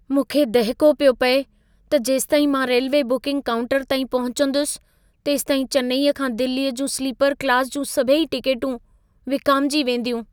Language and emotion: Sindhi, fearful